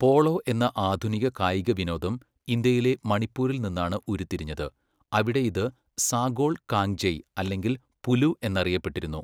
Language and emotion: Malayalam, neutral